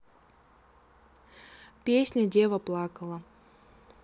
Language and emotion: Russian, neutral